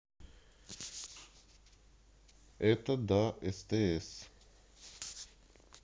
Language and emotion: Russian, neutral